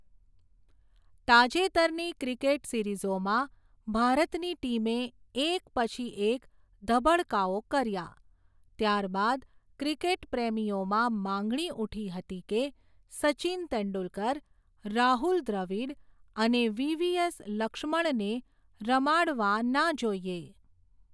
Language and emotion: Gujarati, neutral